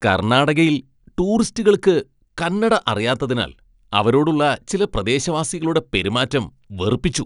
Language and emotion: Malayalam, disgusted